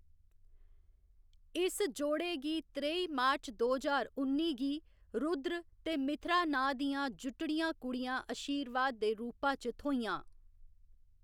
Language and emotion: Dogri, neutral